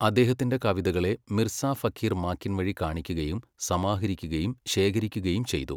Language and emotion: Malayalam, neutral